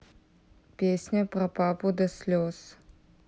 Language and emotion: Russian, neutral